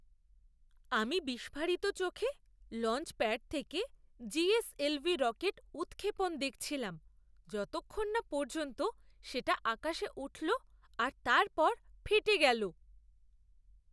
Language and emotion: Bengali, surprised